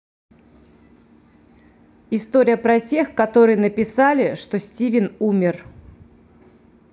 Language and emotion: Russian, neutral